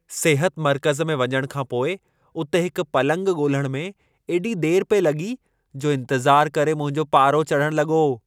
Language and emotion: Sindhi, angry